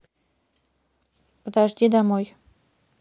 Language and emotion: Russian, neutral